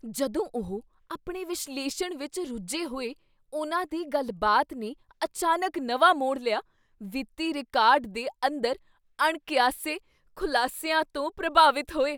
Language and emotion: Punjabi, surprised